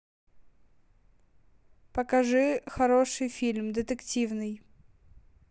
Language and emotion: Russian, neutral